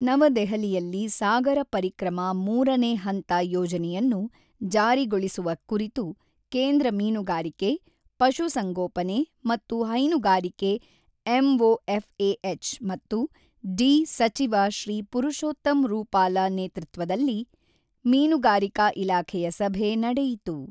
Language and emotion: Kannada, neutral